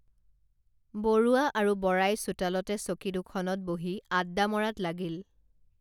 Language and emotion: Assamese, neutral